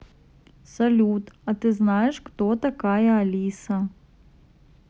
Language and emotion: Russian, neutral